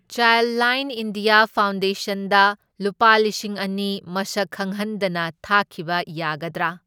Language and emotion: Manipuri, neutral